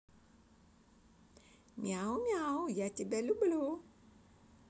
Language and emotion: Russian, positive